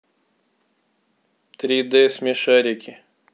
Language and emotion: Russian, neutral